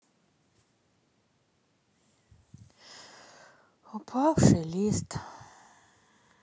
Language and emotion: Russian, sad